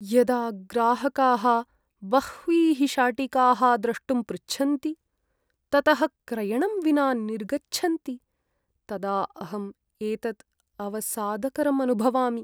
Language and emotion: Sanskrit, sad